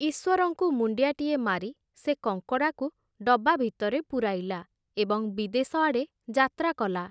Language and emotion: Odia, neutral